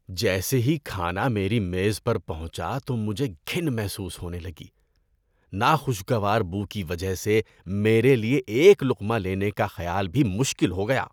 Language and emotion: Urdu, disgusted